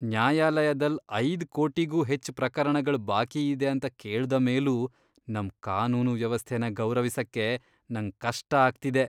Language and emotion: Kannada, disgusted